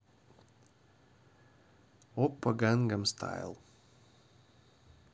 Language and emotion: Russian, neutral